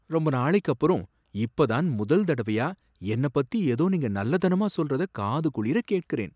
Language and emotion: Tamil, surprised